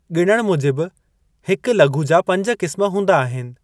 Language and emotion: Sindhi, neutral